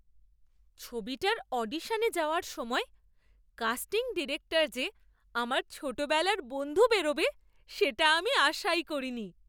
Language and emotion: Bengali, surprised